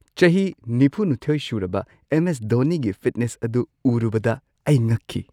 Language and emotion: Manipuri, surprised